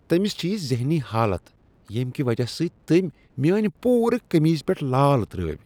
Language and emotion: Kashmiri, disgusted